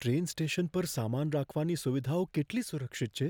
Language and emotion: Gujarati, fearful